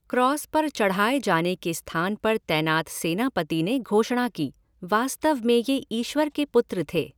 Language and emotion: Hindi, neutral